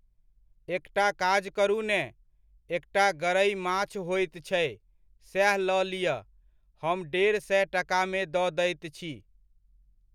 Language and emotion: Maithili, neutral